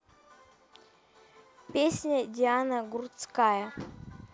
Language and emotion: Russian, neutral